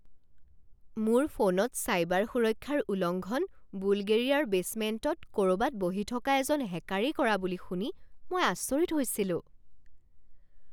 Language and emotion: Assamese, surprised